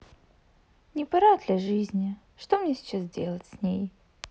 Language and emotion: Russian, sad